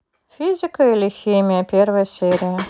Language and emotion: Russian, neutral